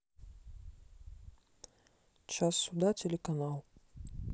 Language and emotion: Russian, neutral